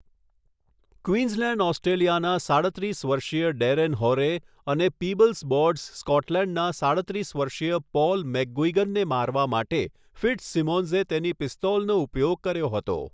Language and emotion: Gujarati, neutral